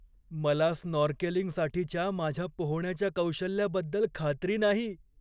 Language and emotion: Marathi, fearful